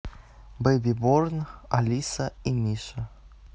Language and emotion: Russian, neutral